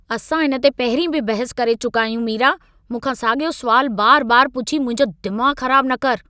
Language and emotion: Sindhi, angry